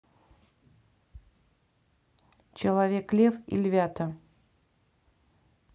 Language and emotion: Russian, neutral